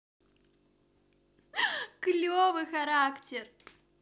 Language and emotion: Russian, positive